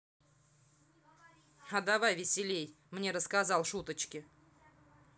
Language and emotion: Russian, angry